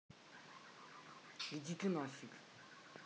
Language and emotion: Russian, angry